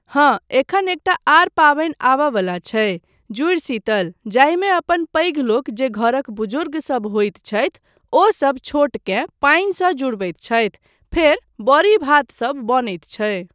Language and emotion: Maithili, neutral